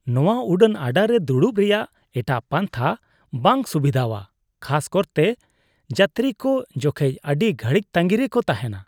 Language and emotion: Santali, disgusted